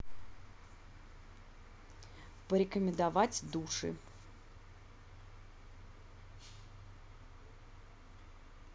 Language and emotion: Russian, neutral